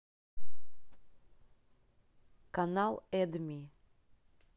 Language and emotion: Russian, neutral